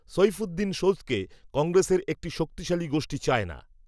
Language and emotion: Bengali, neutral